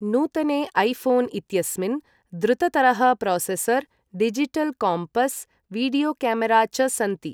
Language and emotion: Sanskrit, neutral